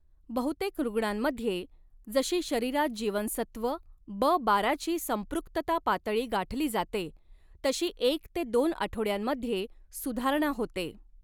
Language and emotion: Marathi, neutral